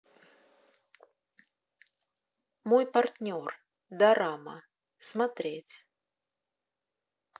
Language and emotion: Russian, neutral